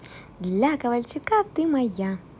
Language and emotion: Russian, positive